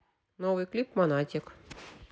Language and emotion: Russian, neutral